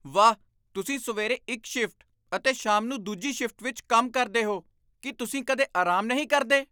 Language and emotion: Punjabi, surprised